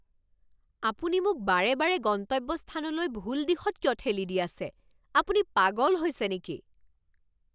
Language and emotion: Assamese, angry